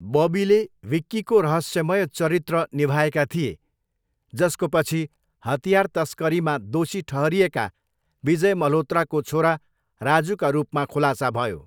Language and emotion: Nepali, neutral